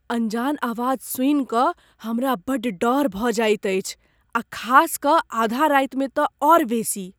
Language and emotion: Maithili, fearful